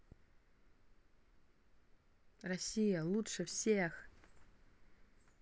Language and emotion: Russian, positive